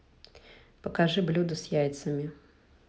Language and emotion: Russian, neutral